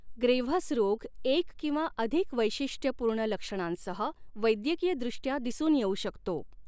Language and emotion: Marathi, neutral